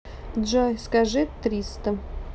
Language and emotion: Russian, neutral